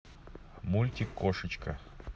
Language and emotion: Russian, neutral